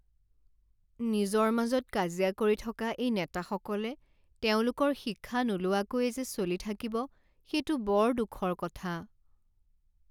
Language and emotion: Assamese, sad